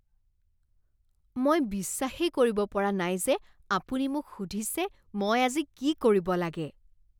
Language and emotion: Assamese, disgusted